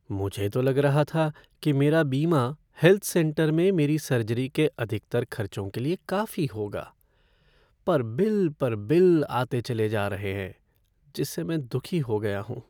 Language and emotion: Hindi, sad